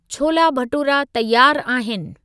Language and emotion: Sindhi, neutral